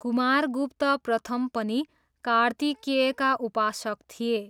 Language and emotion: Nepali, neutral